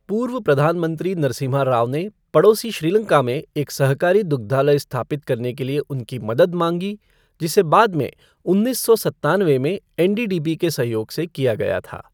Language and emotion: Hindi, neutral